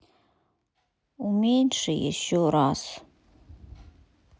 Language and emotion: Russian, sad